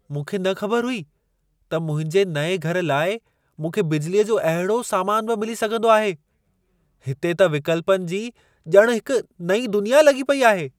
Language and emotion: Sindhi, surprised